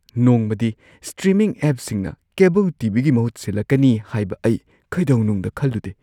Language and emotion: Manipuri, surprised